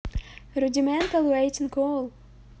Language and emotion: Russian, neutral